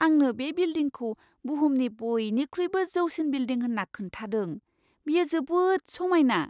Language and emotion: Bodo, surprised